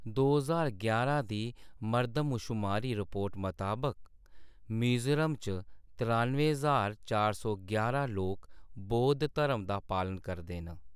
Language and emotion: Dogri, neutral